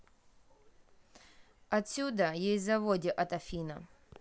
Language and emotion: Russian, neutral